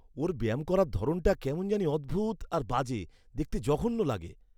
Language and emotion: Bengali, disgusted